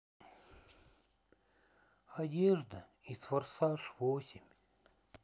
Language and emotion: Russian, sad